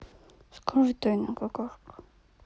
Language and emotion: Russian, sad